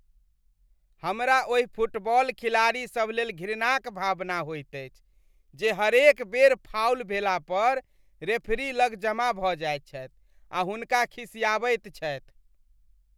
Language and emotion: Maithili, disgusted